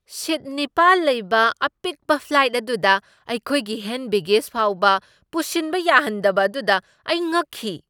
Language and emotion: Manipuri, surprised